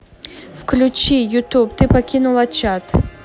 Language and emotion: Russian, neutral